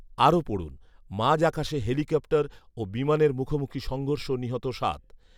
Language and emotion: Bengali, neutral